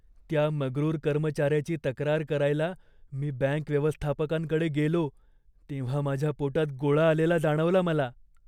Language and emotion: Marathi, fearful